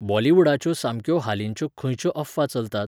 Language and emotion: Goan Konkani, neutral